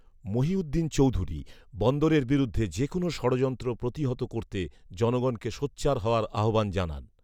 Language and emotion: Bengali, neutral